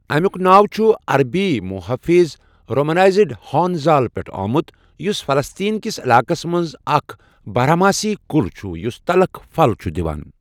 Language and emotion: Kashmiri, neutral